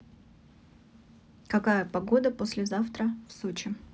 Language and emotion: Russian, neutral